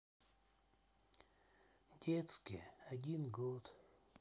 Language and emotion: Russian, sad